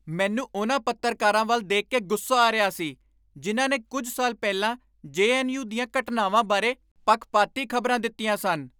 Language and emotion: Punjabi, angry